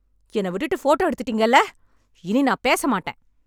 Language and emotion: Tamil, angry